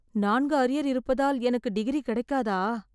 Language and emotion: Tamil, fearful